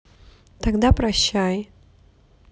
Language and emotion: Russian, neutral